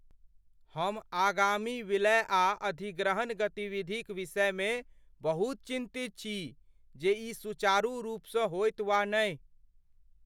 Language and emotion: Maithili, fearful